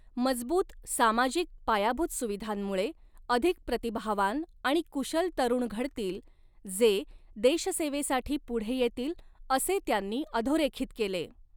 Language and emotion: Marathi, neutral